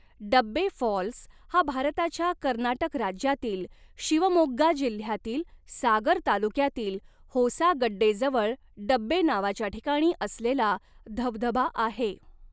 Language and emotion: Marathi, neutral